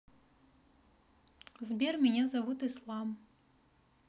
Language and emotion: Russian, neutral